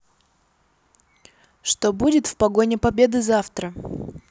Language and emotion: Russian, neutral